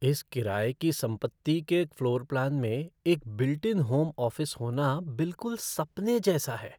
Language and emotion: Hindi, surprised